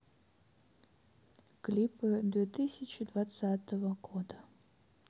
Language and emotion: Russian, neutral